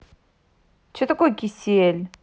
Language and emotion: Russian, angry